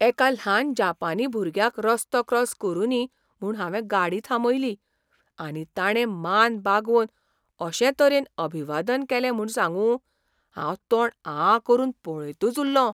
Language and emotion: Goan Konkani, surprised